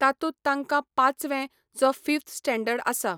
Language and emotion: Goan Konkani, neutral